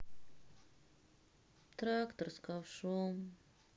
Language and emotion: Russian, sad